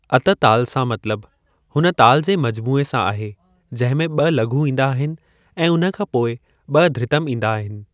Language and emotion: Sindhi, neutral